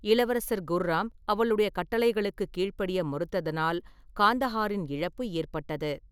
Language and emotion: Tamil, neutral